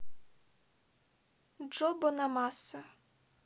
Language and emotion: Russian, neutral